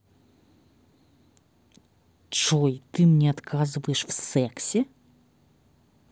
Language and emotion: Russian, angry